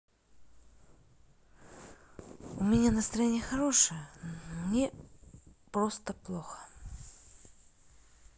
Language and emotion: Russian, sad